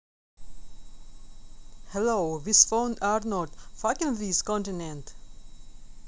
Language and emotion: Russian, neutral